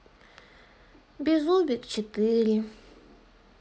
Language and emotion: Russian, sad